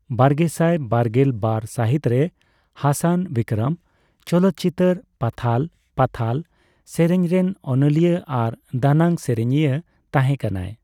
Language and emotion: Santali, neutral